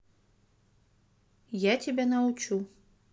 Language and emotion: Russian, neutral